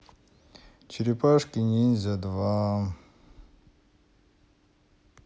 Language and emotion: Russian, sad